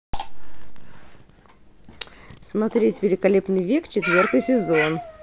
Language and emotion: Russian, positive